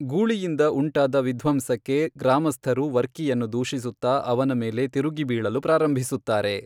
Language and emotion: Kannada, neutral